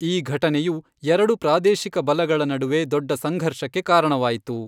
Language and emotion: Kannada, neutral